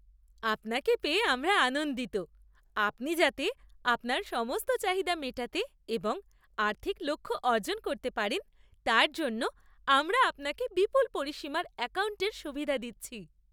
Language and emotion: Bengali, happy